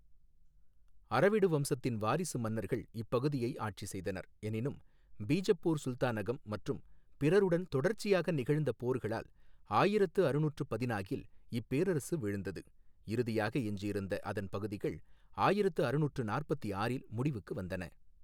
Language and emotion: Tamil, neutral